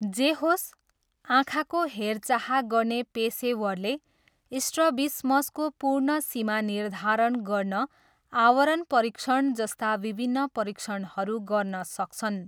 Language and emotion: Nepali, neutral